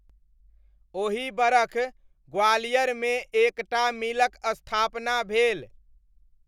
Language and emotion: Maithili, neutral